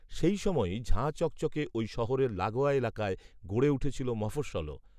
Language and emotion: Bengali, neutral